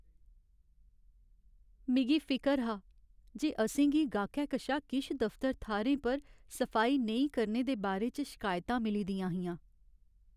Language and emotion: Dogri, sad